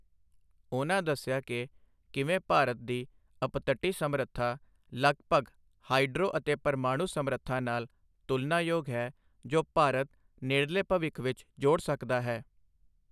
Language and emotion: Punjabi, neutral